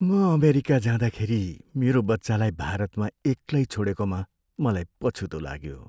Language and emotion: Nepali, sad